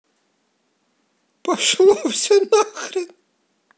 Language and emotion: Russian, positive